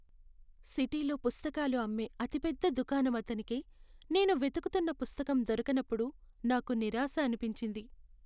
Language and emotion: Telugu, sad